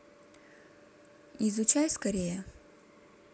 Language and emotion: Russian, neutral